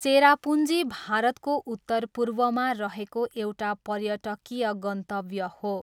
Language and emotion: Nepali, neutral